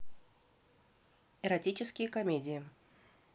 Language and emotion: Russian, neutral